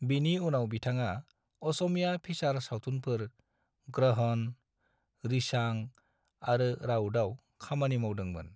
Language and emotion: Bodo, neutral